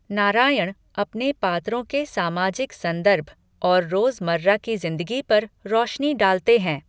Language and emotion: Hindi, neutral